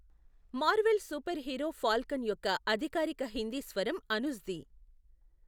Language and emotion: Telugu, neutral